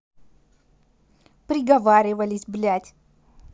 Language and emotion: Russian, angry